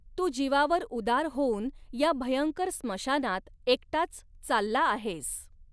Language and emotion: Marathi, neutral